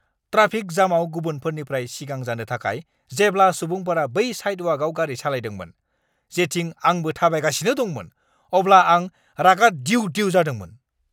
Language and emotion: Bodo, angry